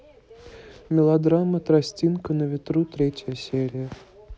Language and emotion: Russian, neutral